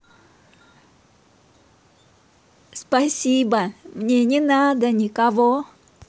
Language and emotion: Russian, positive